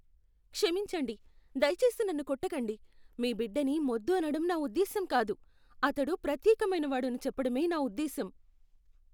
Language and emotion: Telugu, fearful